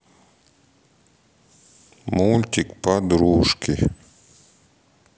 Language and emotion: Russian, sad